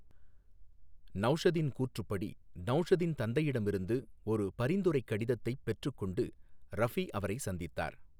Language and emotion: Tamil, neutral